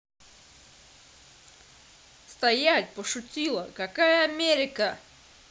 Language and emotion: Russian, angry